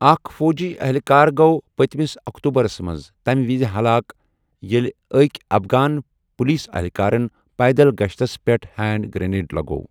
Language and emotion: Kashmiri, neutral